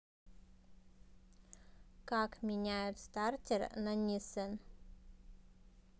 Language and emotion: Russian, neutral